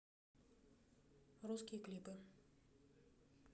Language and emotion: Russian, neutral